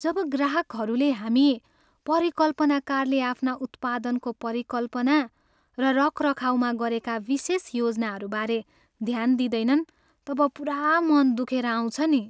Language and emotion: Nepali, sad